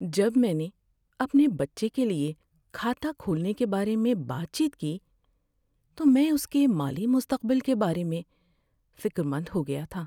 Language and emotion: Urdu, sad